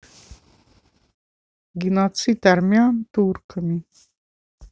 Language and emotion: Russian, neutral